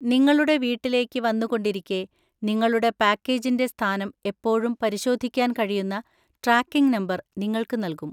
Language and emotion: Malayalam, neutral